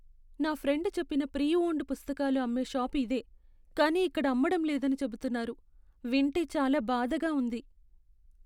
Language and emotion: Telugu, sad